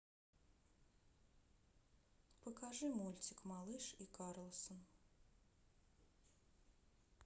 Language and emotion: Russian, sad